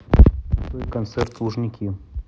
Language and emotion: Russian, neutral